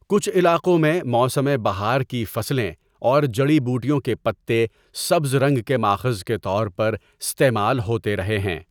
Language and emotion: Urdu, neutral